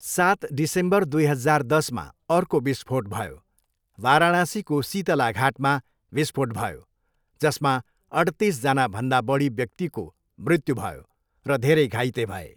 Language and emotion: Nepali, neutral